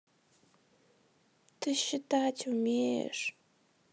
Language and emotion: Russian, sad